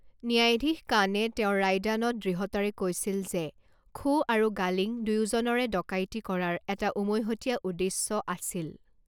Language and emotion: Assamese, neutral